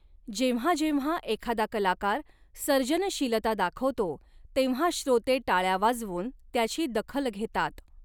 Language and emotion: Marathi, neutral